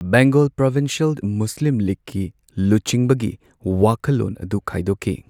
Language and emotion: Manipuri, neutral